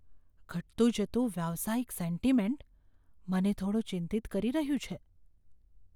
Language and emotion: Gujarati, fearful